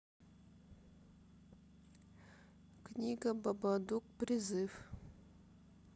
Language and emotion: Russian, sad